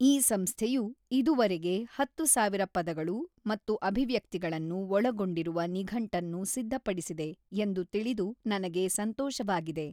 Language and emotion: Kannada, neutral